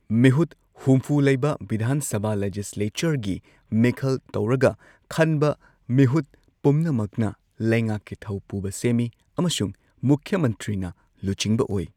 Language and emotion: Manipuri, neutral